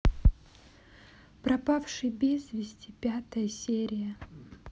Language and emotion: Russian, neutral